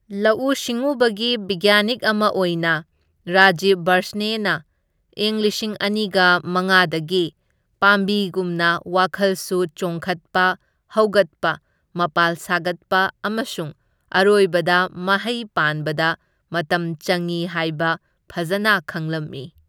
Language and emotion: Manipuri, neutral